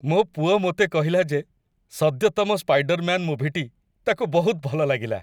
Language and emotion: Odia, happy